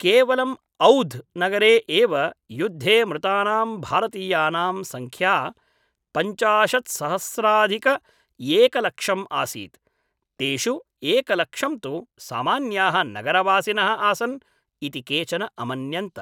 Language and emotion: Sanskrit, neutral